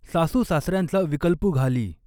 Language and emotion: Marathi, neutral